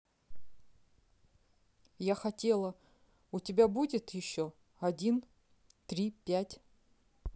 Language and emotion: Russian, neutral